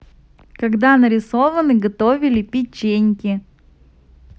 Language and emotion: Russian, positive